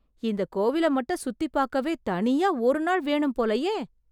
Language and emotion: Tamil, surprised